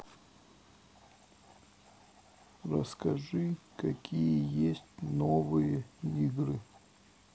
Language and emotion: Russian, sad